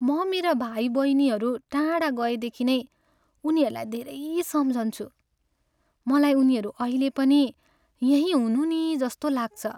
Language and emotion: Nepali, sad